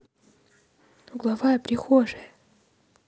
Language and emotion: Russian, positive